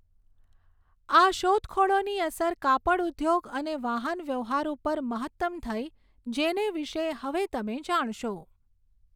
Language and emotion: Gujarati, neutral